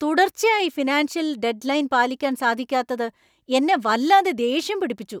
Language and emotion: Malayalam, angry